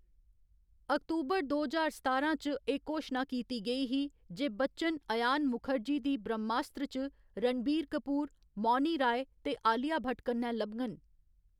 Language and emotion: Dogri, neutral